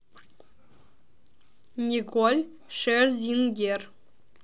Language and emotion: Russian, neutral